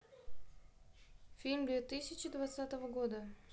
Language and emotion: Russian, neutral